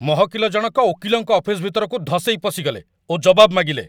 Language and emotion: Odia, angry